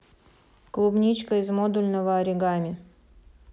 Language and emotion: Russian, neutral